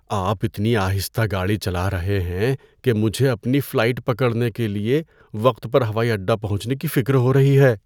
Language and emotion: Urdu, fearful